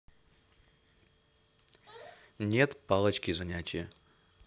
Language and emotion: Russian, neutral